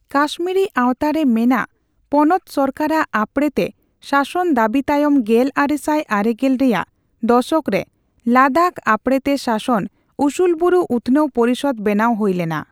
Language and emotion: Santali, neutral